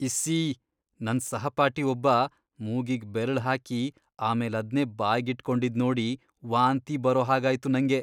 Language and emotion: Kannada, disgusted